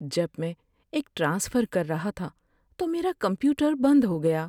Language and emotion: Urdu, sad